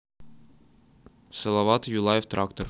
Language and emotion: Russian, neutral